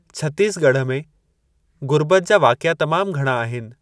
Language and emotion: Sindhi, neutral